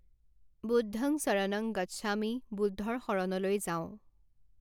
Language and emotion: Assamese, neutral